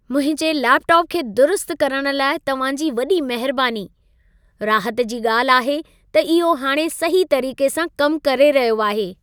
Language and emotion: Sindhi, happy